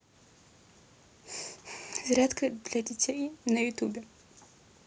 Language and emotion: Russian, sad